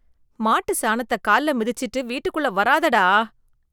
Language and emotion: Tamil, disgusted